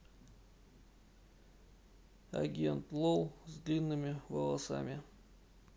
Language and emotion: Russian, neutral